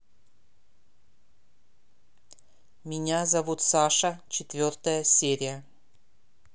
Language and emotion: Russian, neutral